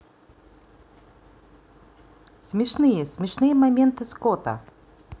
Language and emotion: Russian, positive